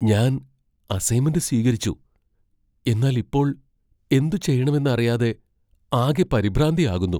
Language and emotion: Malayalam, fearful